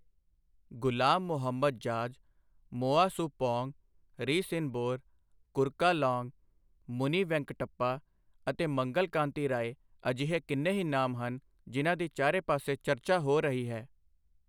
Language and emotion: Punjabi, neutral